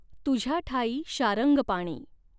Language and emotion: Marathi, neutral